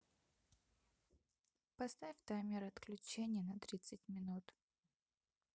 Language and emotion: Russian, neutral